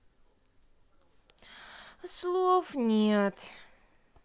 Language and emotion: Russian, sad